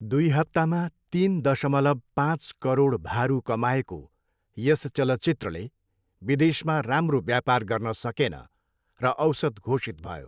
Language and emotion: Nepali, neutral